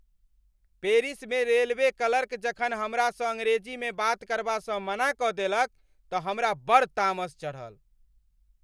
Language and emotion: Maithili, angry